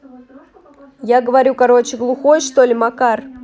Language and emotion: Russian, angry